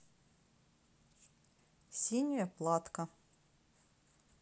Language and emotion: Russian, neutral